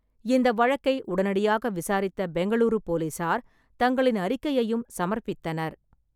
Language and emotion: Tamil, neutral